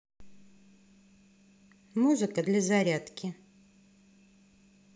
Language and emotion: Russian, neutral